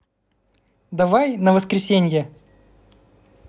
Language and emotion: Russian, positive